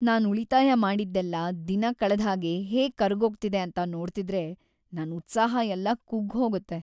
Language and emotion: Kannada, sad